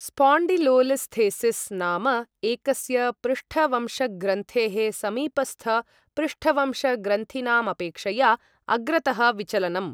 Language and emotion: Sanskrit, neutral